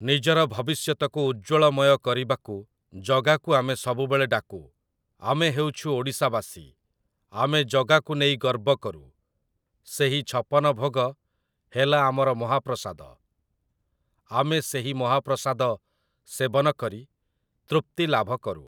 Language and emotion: Odia, neutral